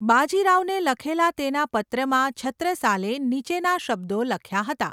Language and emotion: Gujarati, neutral